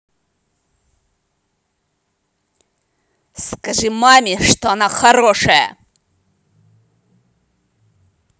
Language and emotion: Russian, angry